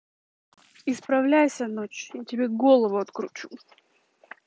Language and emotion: Russian, angry